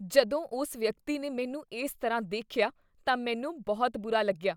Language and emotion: Punjabi, disgusted